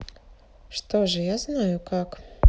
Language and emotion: Russian, neutral